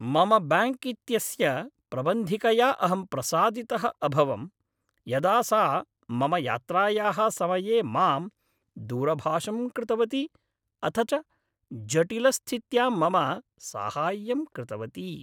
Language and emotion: Sanskrit, happy